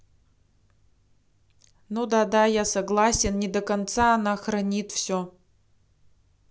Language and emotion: Russian, neutral